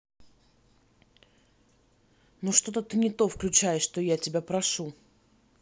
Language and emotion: Russian, angry